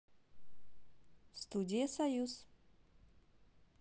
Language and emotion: Russian, positive